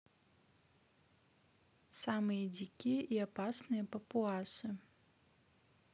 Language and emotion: Russian, neutral